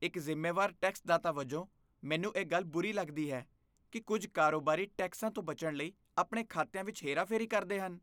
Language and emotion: Punjabi, disgusted